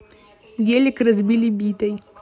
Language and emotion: Russian, neutral